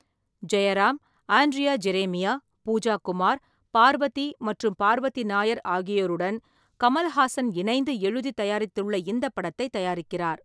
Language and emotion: Tamil, neutral